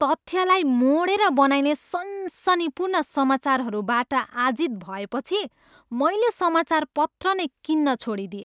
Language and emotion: Nepali, disgusted